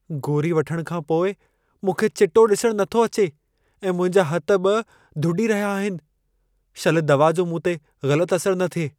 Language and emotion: Sindhi, fearful